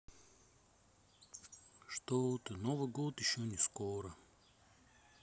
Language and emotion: Russian, sad